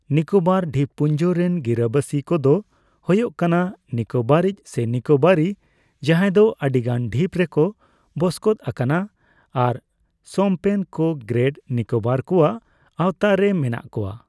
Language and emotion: Santali, neutral